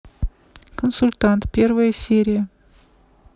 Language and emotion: Russian, neutral